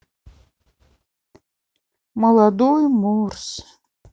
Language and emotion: Russian, sad